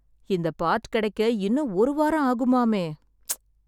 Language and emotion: Tamil, sad